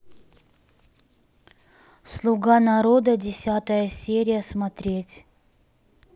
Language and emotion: Russian, neutral